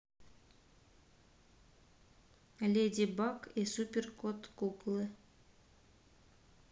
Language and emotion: Russian, neutral